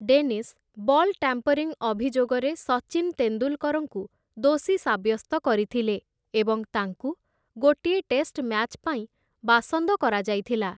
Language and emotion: Odia, neutral